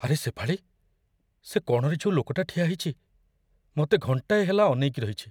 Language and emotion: Odia, fearful